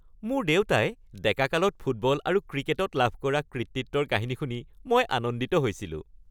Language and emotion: Assamese, happy